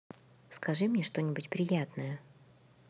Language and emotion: Russian, neutral